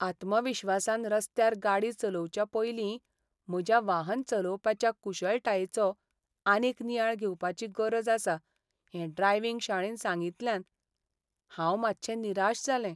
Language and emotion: Goan Konkani, sad